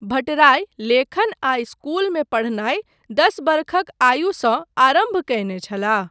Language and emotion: Maithili, neutral